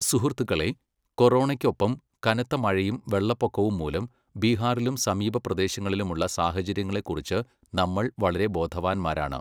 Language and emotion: Malayalam, neutral